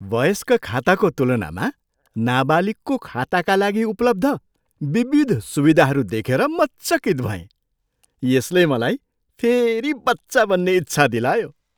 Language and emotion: Nepali, surprised